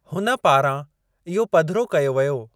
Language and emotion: Sindhi, neutral